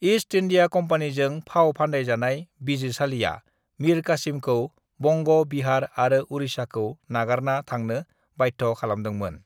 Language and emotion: Bodo, neutral